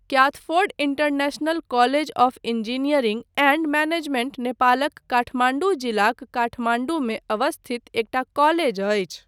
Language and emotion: Maithili, neutral